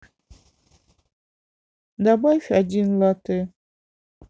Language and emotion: Russian, sad